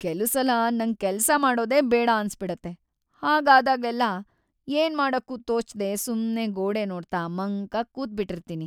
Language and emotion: Kannada, sad